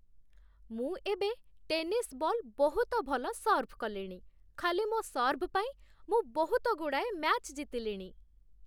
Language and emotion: Odia, happy